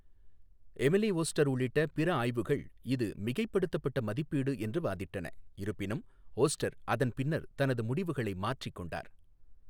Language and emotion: Tamil, neutral